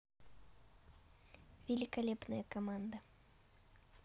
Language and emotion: Russian, neutral